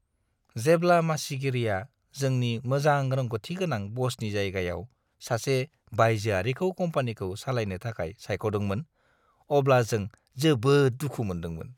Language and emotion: Bodo, disgusted